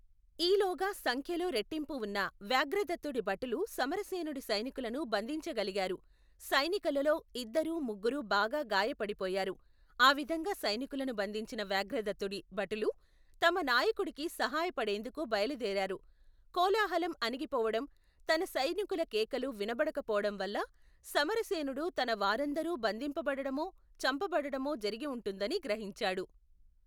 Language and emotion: Telugu, neutral